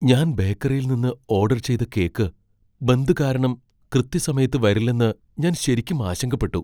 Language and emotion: Malayalam, fearful